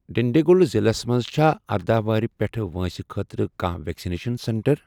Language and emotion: Kashmiri, neutral